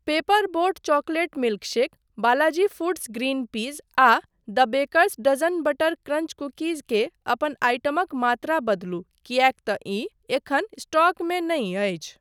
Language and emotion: Maithili, neutral